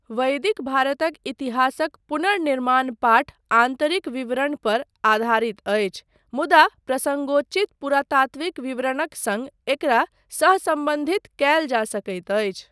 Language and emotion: Maithili, neutral